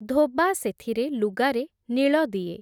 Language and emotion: Odia, neutral